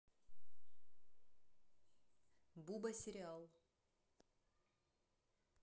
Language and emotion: Russian, neutral